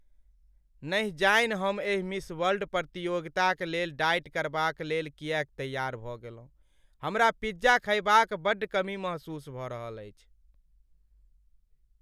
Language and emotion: Maithili, sad